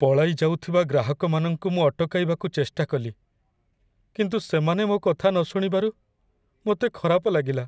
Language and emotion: Odia, sad